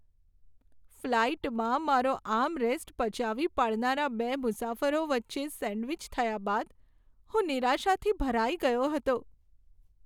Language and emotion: Gujarati, sad